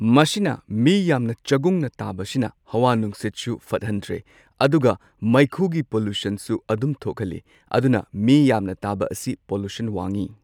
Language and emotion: Manipuri, neutral